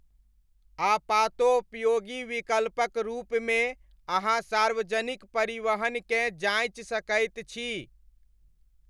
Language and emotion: Maithili, neutral